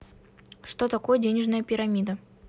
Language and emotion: Russian, neutral